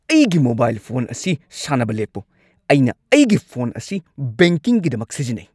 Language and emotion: Manipuri, angry